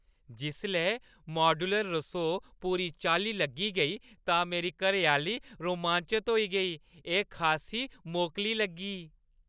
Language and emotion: Dogri, happy